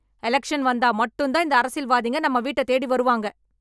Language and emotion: Tamil, angry